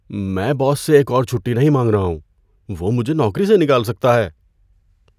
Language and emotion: Urdu, fearful